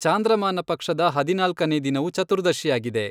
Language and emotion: Kannada, neutral